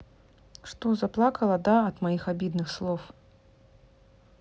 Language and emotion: Russian, neutral